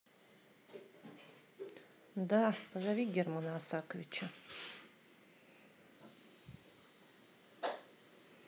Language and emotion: Russian, neutral